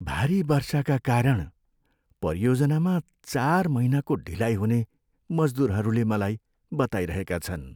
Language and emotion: Nepali, sad